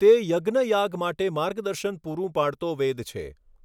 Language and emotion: Gujarati, neutral